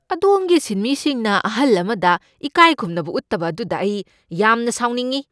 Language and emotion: Manipuri, angry